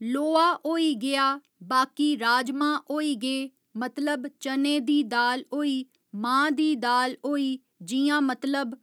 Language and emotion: Dogri, neutral